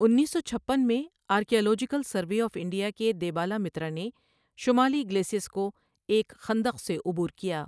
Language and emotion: Urdu, neutral